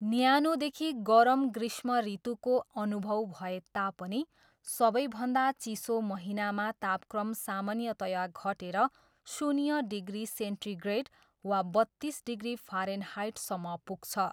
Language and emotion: Nepali, neutral